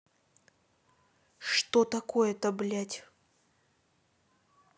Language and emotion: Russian, angry